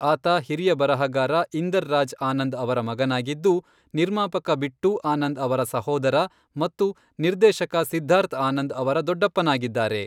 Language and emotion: Kannada, neutral